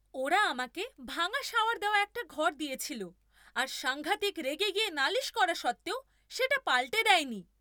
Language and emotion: Bengali, angry